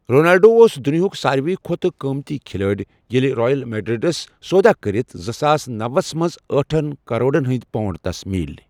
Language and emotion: Kashmiri, neutral